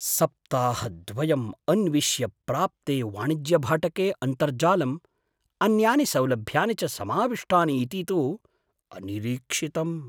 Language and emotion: Sanskrit, surprised